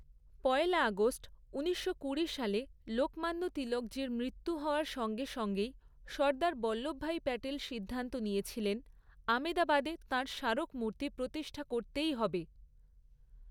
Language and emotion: Bengali, neutral